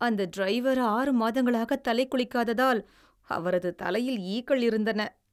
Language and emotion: Tamil, disgusted